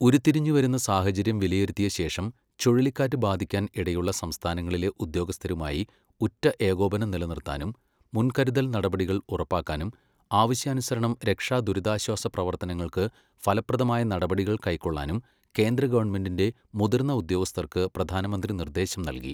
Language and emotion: Malayalam, neutral